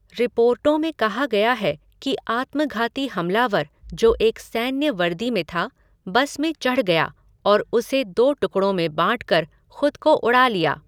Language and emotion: Hindi, neutral